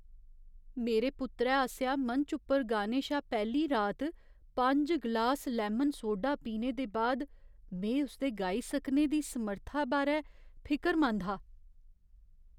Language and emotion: Dogri, fearful